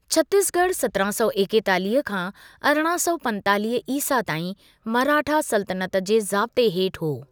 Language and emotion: Sindhi, neutral